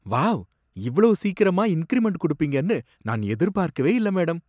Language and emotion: Tamil, surprised